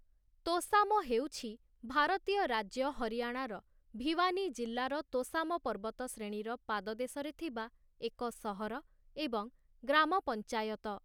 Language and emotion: Odia, neutral